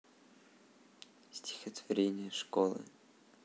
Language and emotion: Russian, sad